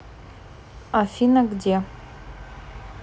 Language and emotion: Russian, neutral